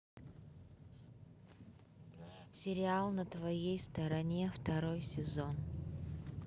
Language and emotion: Russian, neutral